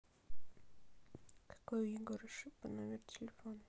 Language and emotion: Russian, neutral